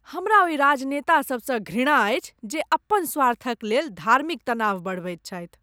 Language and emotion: Maithili, disgusted